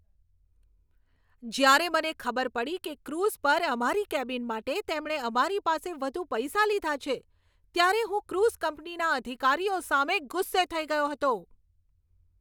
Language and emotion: Gujarati, angry